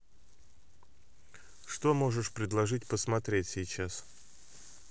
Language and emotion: Russian, neutral